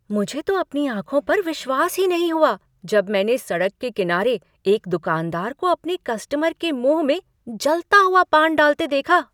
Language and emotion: Hindi, surprised